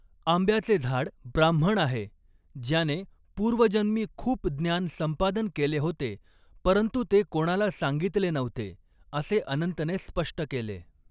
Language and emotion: Marathi, neutral